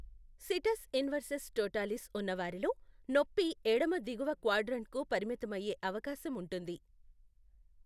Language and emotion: Telugu, neutral